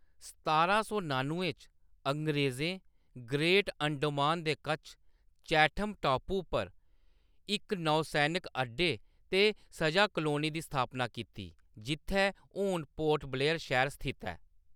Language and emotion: Dogri, neutral